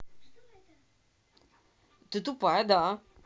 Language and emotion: Russian, angry